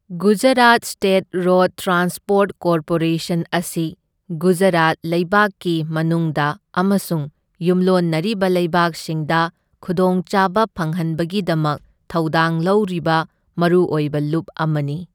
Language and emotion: Manipuri, neutral